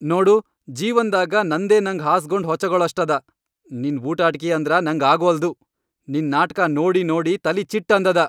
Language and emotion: Kannada, angry